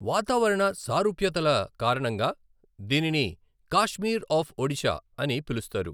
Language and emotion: Telugu, neutral